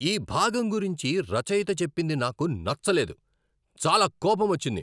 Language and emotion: Telugu, angry